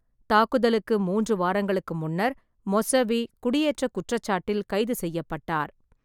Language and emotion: Tamil, neutral